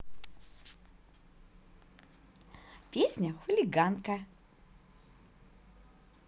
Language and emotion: Russian, positive